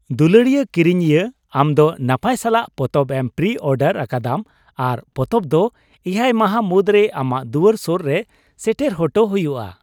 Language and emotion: Santali, happy